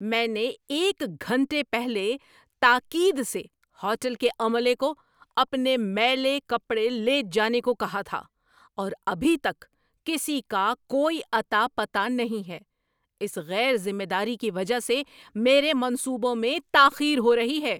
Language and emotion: Urdu, angry